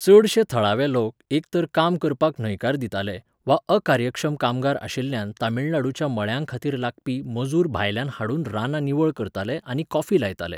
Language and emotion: Goan Konkani, neutral